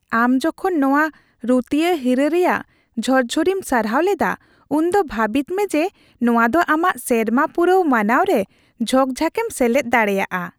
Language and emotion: Santali, happy